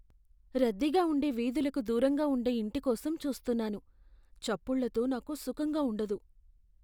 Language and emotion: Telugu, fearful